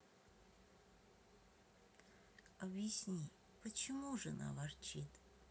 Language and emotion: Russian, sad